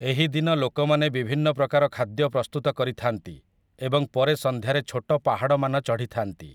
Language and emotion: Odia, neutral